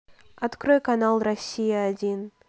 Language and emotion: Russian, neutral